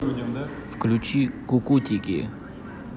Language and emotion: Russian, neutral